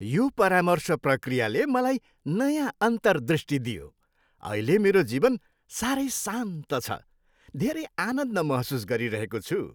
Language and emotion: Nepali, happy